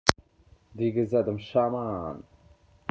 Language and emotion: Russian, neutral